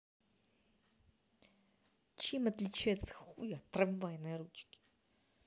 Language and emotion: Russian, angry